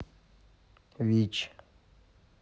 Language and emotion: Russian, neutral